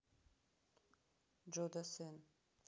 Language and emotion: Russian, neutral